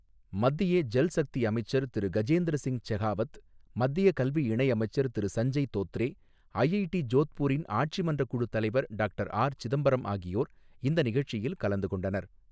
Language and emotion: Tamil, neutral